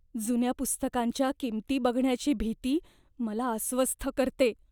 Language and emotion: Marathi, fearful